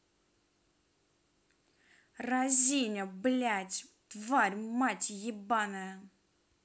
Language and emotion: Russian, angry